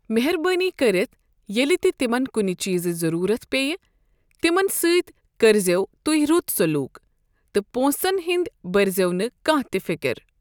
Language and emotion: Kashmiri, neutral